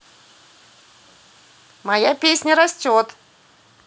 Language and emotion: Russian, positive